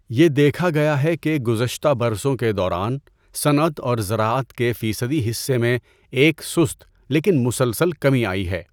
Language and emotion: Urdu, neutral